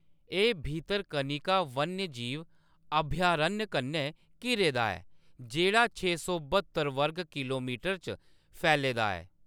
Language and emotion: Dogri, neutral